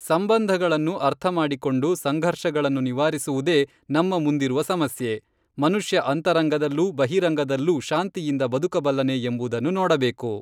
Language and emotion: Kannada, neutral